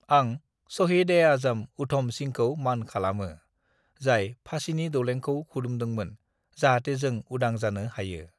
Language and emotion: Bodo, neutral